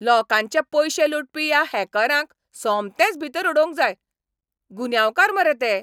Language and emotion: Goan Konkani, angry